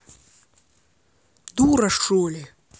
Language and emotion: Russian, angry